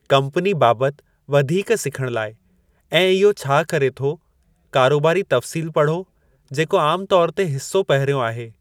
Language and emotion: Sindhi, neutral